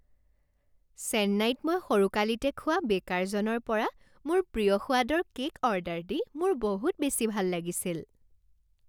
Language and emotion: Assamese, happy